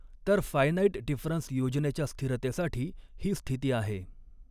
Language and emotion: Marathi, neutral